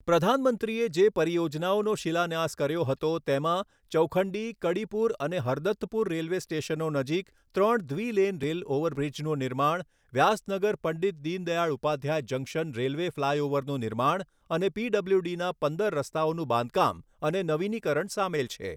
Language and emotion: Gujarati, neutral